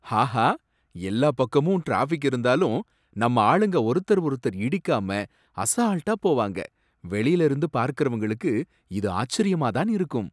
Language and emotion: Tamil, surprised